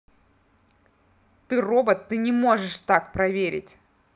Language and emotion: Russian, angry